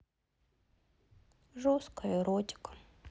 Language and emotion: Russian, sad